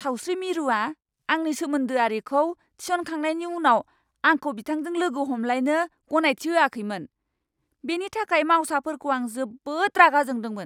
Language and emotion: Bodo, angry